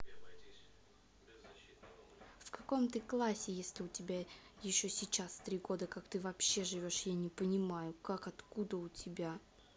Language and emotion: Russian, angry